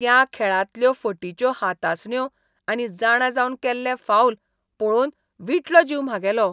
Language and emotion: Goan Konkani, disgusted